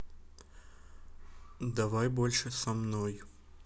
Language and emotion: Russian, neutral